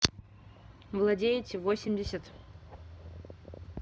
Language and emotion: Russian, neutral